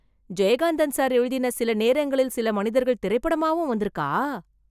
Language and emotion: Tamil, surprised